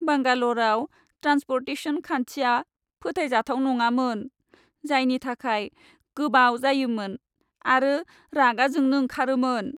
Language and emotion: Bodo, sad